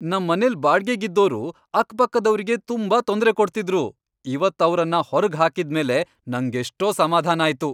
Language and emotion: Kannada, happy